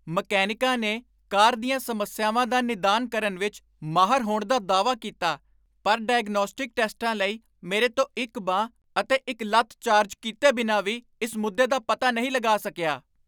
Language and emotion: Punjabi, angry